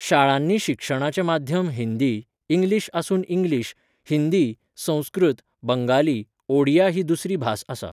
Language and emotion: Goan Konkani, neutral